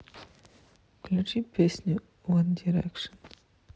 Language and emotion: Russian, neutral